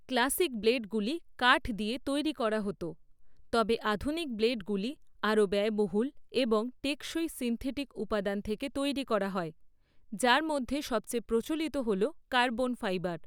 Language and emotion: Bengali, neutral